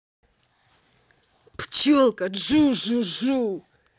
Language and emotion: Russian, angry